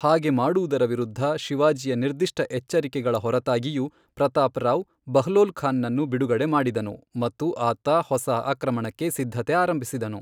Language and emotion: Kannada, neutral